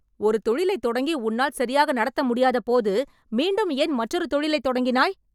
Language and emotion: Tamil, angry